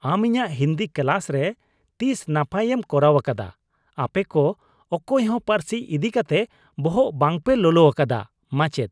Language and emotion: Santali, disgusted